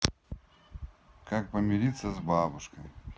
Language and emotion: Russian, neutral